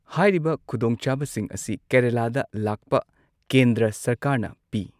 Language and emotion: Manipuri, neutral